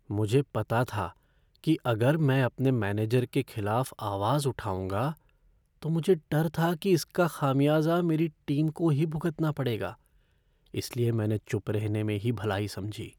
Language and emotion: Hindi, fearful